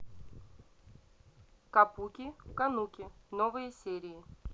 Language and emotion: Russian, neutral